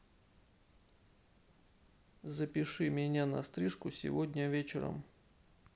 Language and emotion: Russian, neutral